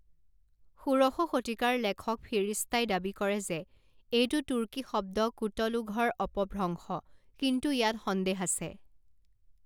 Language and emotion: Assamese, neutral